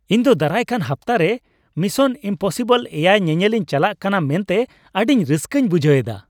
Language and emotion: Santali, happy